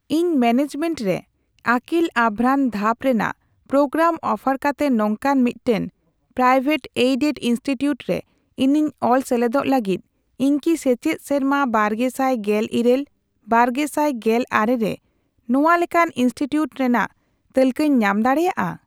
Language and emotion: Santali, neutral